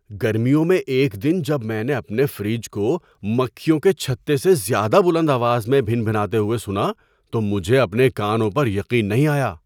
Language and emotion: Urdu, surprised